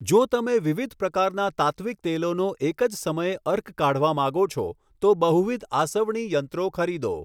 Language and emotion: Gujarati, neutral